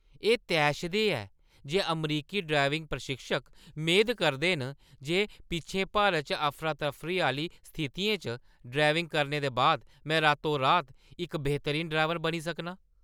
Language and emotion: Dogri, angry